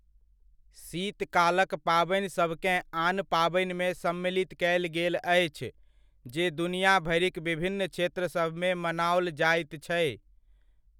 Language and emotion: Maithili, neutral